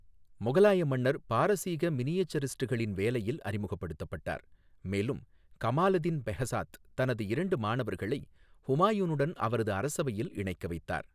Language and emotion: Tamil, neutral